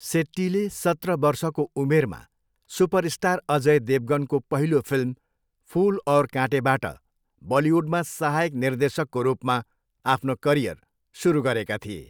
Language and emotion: Nepali, neutral